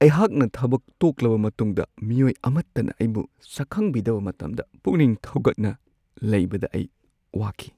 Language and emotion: Manipuri, sad